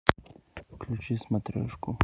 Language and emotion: Russian, neutral